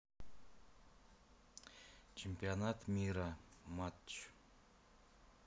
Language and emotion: Russian, neutral